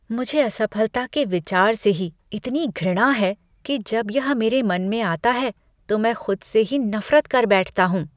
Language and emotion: Hindi, disgusted